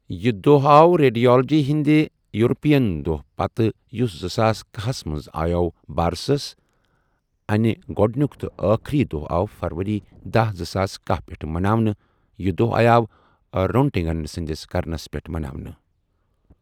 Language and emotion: Kashmiri, neutral